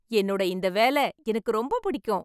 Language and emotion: Tamil, happy